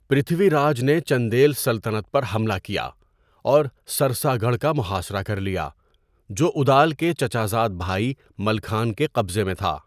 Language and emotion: Urdu, neutral